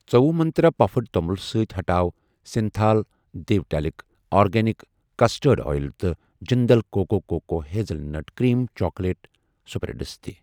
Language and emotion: Kashmiri, neutral